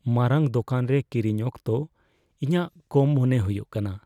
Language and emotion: Santali, fearful